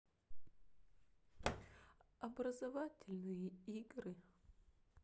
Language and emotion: Russian, sad